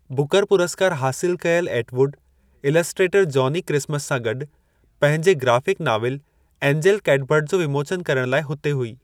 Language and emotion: Sindhi, neutral